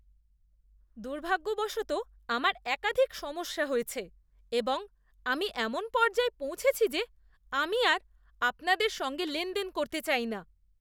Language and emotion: Bengali, disgusted